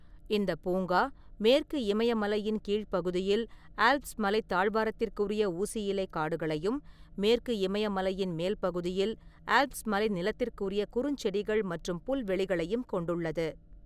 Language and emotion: Tamil, neutral